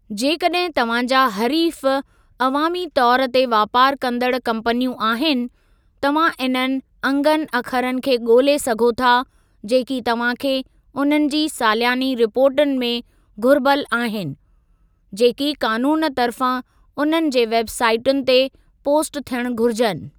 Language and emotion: Sindhi, neutral